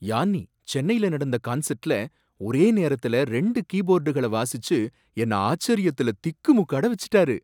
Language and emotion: Tamil, surprised